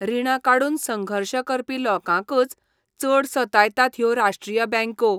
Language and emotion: Goan Konkani, disgusted